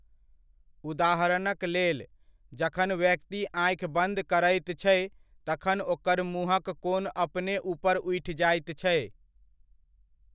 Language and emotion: Maithili, neutral